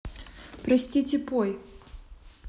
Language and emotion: Russian, neutral